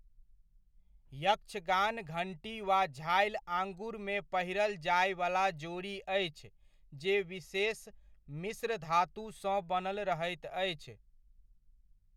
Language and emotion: Maithili, neutral